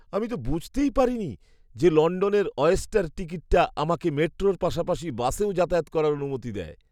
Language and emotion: Bengali, surprised